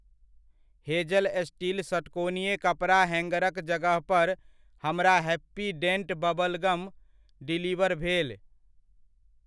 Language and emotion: Maithili, neutral